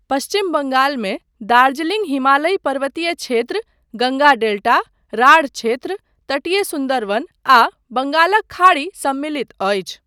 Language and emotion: Maithili, neutral